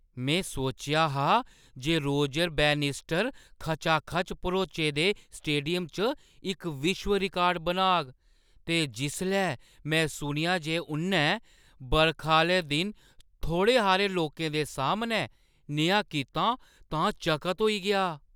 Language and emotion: Dogri, surprised